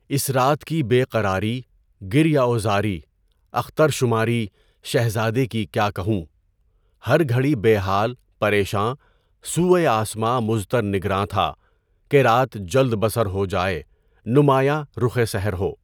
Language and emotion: Urdu, neutral